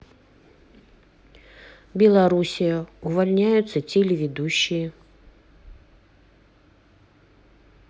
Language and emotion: Russian, neutral